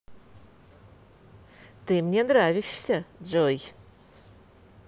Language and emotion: Russian, positive